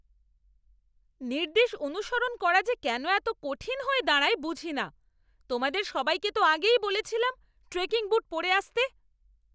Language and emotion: Bengali, angry